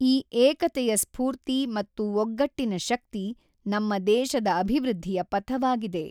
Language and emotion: Kannada, neutral